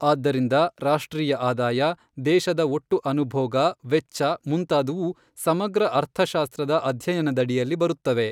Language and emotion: Kannada, neutral